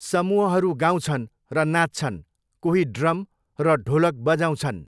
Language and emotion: Nepali, neutral